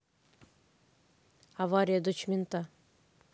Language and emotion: Russian, neutral